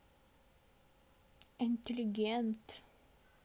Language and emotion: Russian, neutral